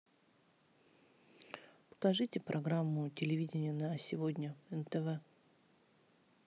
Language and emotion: Russian, neutral